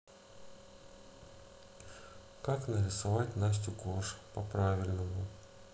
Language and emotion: Russian, neutral